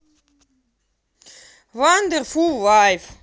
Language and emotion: Russian, angry